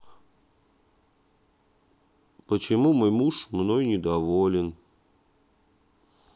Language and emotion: Russian, sad